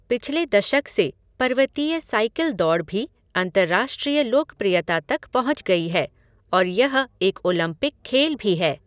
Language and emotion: Hindi, neutral